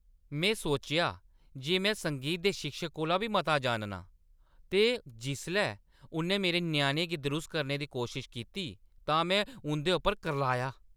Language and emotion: Dogri, angry